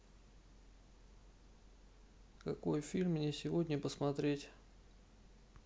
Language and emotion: Russian, neutral